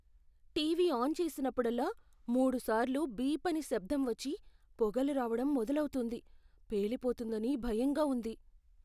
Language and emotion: Telugu, fearful